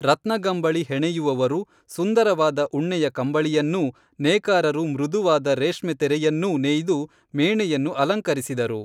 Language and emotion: Kannada, neutral